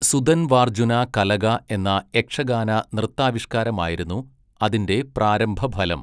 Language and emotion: Malayalam, neutral